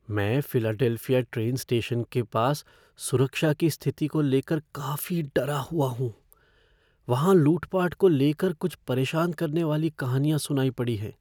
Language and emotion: Hindi, fearful